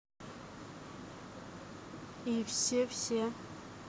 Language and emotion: Russian, neutral